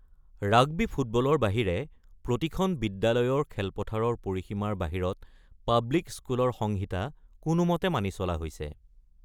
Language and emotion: Assamese, neutral